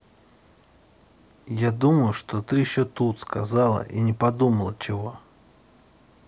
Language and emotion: Russian, neutral